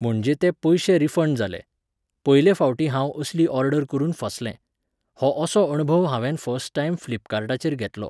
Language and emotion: Goan Konkani, neutral